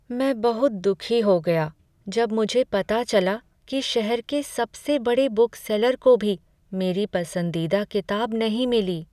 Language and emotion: Hindi, sad